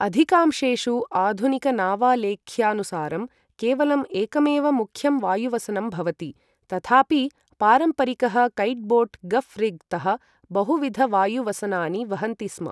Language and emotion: Sanskrit, neutral